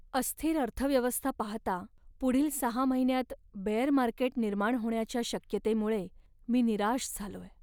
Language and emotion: Marathi, sad